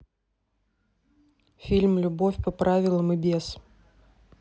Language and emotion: Russian, neutral